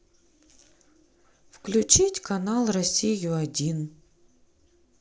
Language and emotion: Russian, neutral